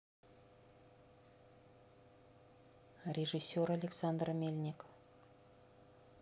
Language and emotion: Russian, neutral